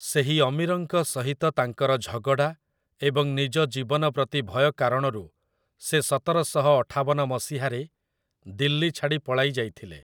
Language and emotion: Odia, neutral